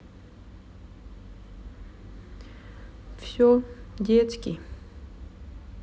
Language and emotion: Russian, sad